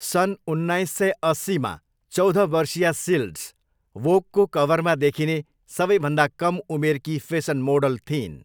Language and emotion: Nepali, neutral